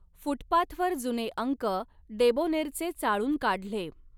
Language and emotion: Marathi, neutral